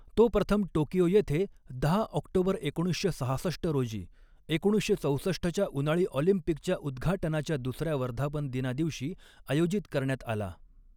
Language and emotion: Marathi, neutral